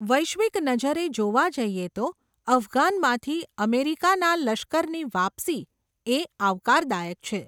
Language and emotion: Gujarati, neutral